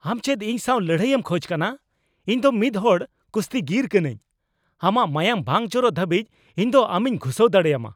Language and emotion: Santali, angry